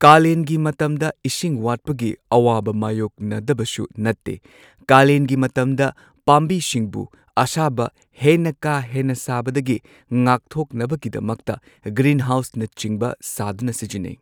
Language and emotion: Manipuri, neutral